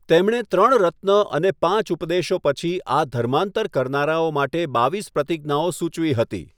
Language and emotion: Gujarati, neutral